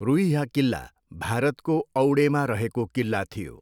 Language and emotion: Nepali, neutral